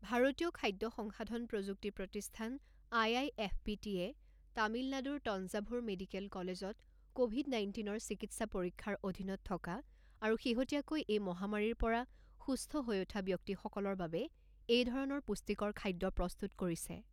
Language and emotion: Assamese, neutral